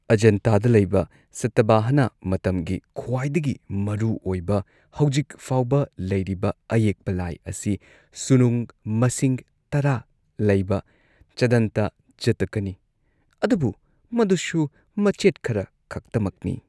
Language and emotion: Manipuri, neutral